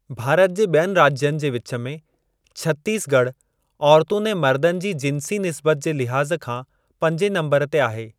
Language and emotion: Sindhi, neutral